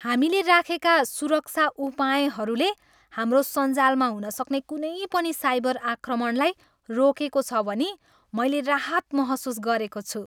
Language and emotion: Nepali, happy